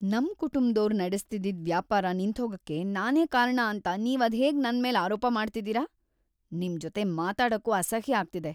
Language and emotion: Kannada, disgusted